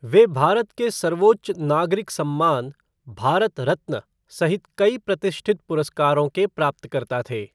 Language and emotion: Hindi, neutral